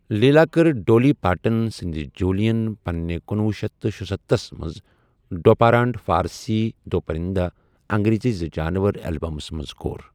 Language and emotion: Kashmiri, neutral